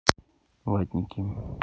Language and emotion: Russian, neutral